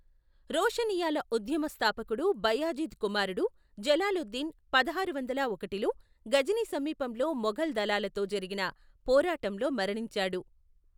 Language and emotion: Telugu, neutral